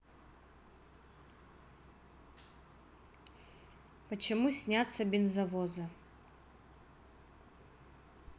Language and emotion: Russian, neutral